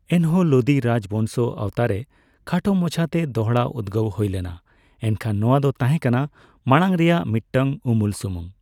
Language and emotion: Santali, neutral